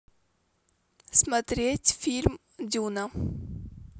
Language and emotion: Russian, neutral